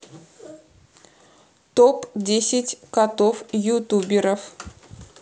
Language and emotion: Russian, neutral